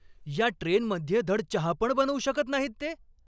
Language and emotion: Marathi, angry